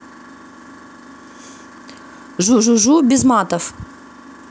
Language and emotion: Russian, neutral